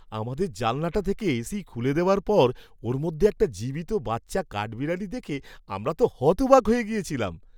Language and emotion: Bengali, surprised